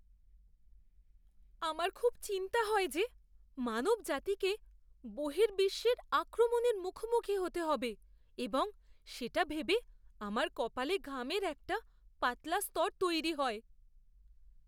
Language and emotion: Bengali, fearful